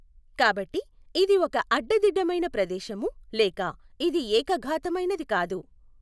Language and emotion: Telugu, neutral